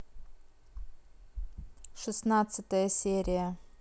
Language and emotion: Russian, neutral